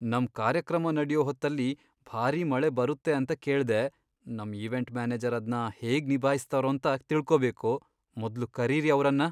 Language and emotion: Kannada, fearful